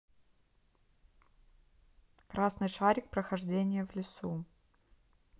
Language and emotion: Russian, neutral